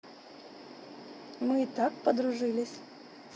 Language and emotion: Russian, neutral